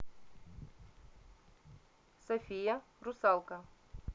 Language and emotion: Russian, neutral